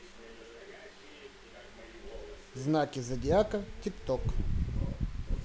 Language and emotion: Russian, neutral